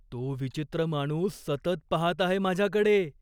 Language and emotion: Marathi, fearful